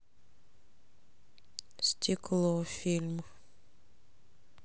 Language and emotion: Russian, neutral